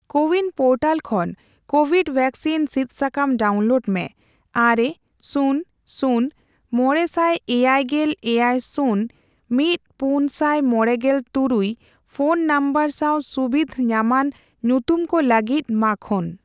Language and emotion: Santali, neutral